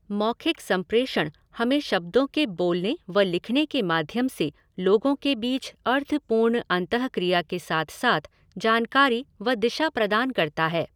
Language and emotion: Hindi, neutral